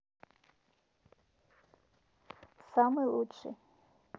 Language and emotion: Russian, neutral